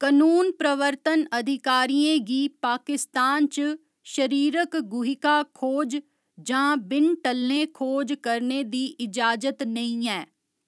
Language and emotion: Dogri, neutral